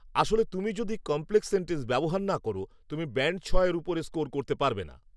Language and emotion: Bengali, neutral